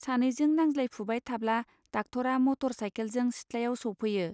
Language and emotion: Bodo, neutral